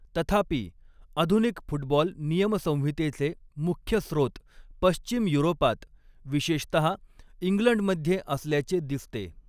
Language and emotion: Marathi, neutral